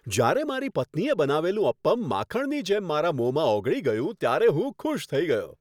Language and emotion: Gujarati, happy